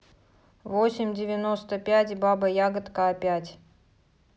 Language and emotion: Russian, neutral